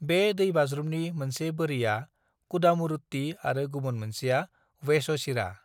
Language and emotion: Bodo, neutral